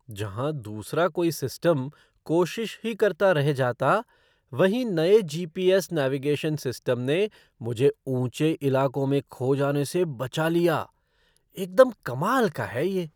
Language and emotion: Hindi, surprised